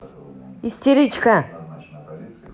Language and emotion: Russian, angry